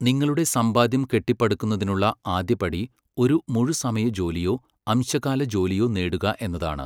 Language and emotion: Malayalam, neutral